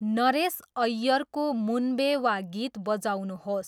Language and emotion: Nepali, neutral